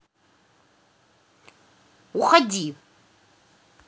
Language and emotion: Russian, angry